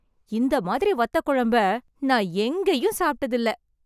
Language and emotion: Tamil, happy